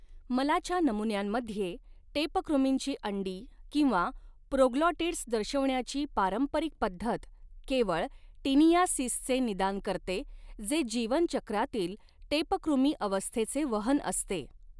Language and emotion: Marathi, neutral